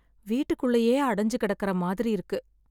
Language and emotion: Tamil, sad